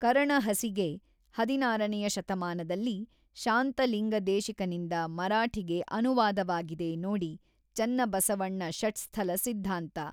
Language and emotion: Kannada, neutral